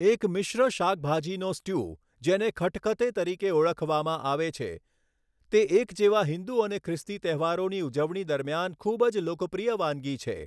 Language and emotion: Gujarati, neutral